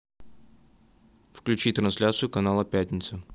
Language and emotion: Russian, neutral